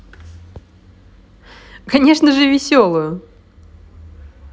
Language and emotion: Russian, positive